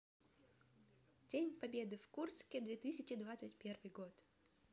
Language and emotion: Russian, neutral